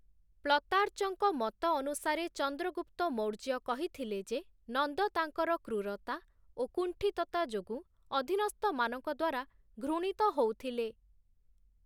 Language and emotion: Odia, neutral